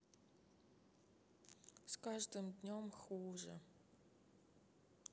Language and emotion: Russian, sad